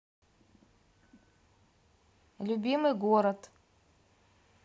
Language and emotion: Russian, neutral